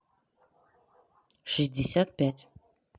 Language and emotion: Russian, neutral